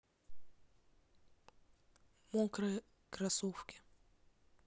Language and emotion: Russian, neutral